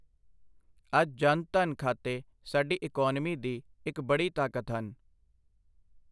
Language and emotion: Punjabi, neutral